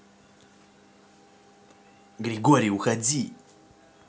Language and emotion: Russian, angry